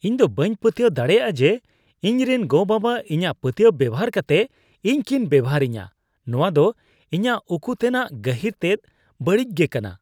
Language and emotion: Santali, disgusted